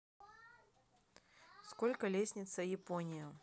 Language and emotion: Russian, neutral